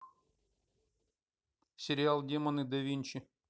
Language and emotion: Russian, neutral